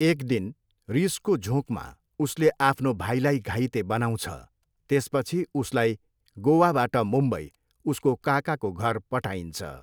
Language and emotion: Nepali, neutral